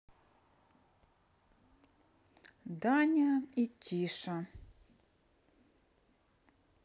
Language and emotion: Russian, neutral